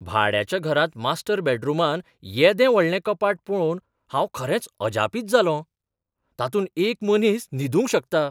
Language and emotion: Goan Konkani, surprised